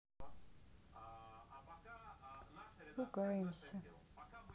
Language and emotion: Russian, sad